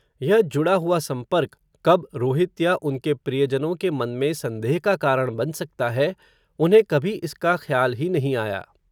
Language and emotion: Hindi, neutral